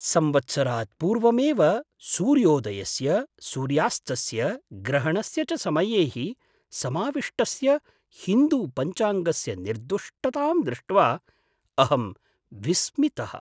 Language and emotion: Sanskrit, surprised